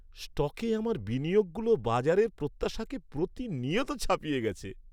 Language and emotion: Bengali, happy